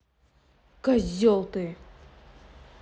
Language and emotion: Russian, angry